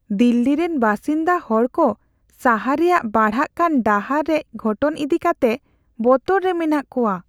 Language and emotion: Santali, fearful